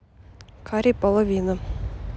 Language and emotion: Russian, neutral